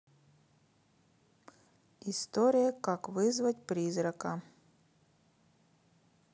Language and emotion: Russian, neutral